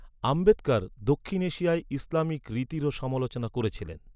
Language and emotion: Bengali, neutral